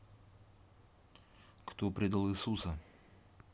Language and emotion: Russian, neutral